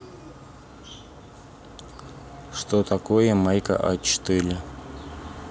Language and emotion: Russian, neutral